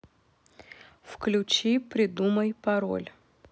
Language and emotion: Russian, neutral